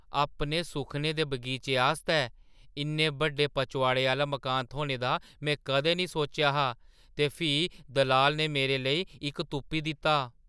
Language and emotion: Dogri, surprised